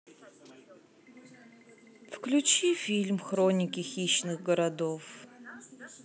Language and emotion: Russian, sad